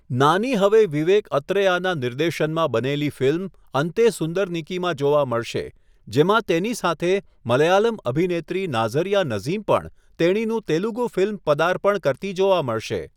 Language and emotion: Gujarati, neutral